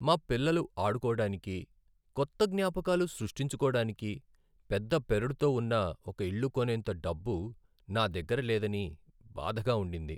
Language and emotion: Telugu, sad